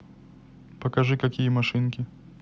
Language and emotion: Russian, neutral